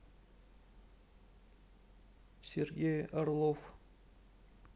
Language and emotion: Russian, neutral